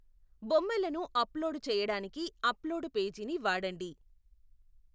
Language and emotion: Telugu, neutral